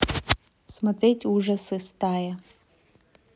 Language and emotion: Russian, neutral